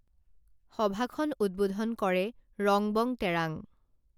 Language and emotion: Assamese, neutral